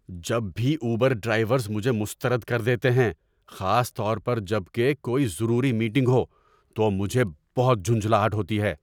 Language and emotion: Urdu, angry